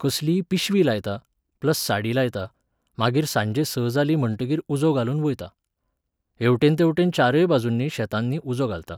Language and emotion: Goan Konkani, neutral